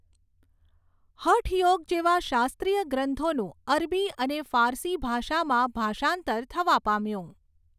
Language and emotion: Gujarati, neutral